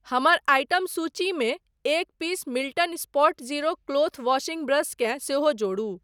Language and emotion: Maithili, neutral